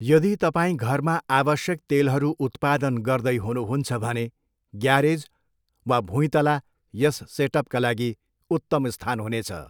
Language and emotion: Nepali, neutral